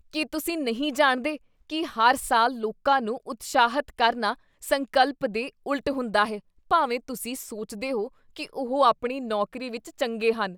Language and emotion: Punjabi, disgusted